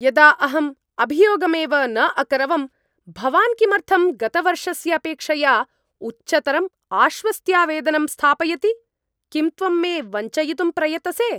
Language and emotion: Sanskrit, angry